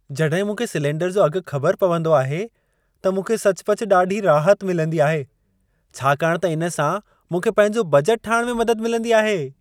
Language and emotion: Sindhi, happy